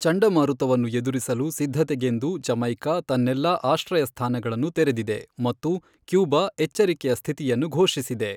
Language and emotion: Kannada, neutral